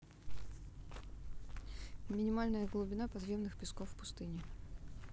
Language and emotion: Russian, neutral